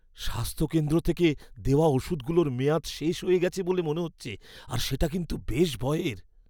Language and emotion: Bengali, fearful